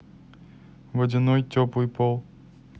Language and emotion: Russian, neutral